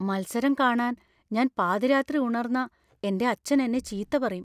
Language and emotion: Malayalam, fearful